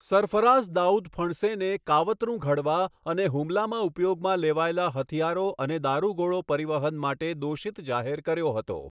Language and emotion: Gujarati, neutral